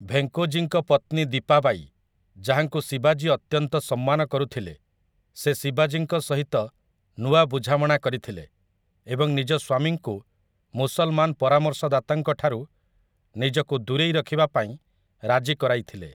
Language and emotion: Odia, neutral